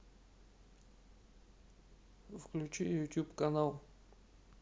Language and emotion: Russian, neutral